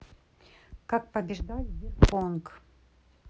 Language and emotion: Russian, neutral